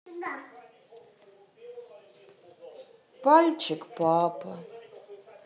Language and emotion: Russian, sad